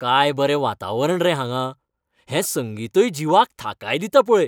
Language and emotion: Goan Konkani, happy